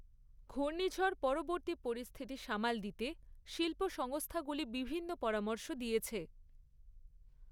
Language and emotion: Bengali, neutral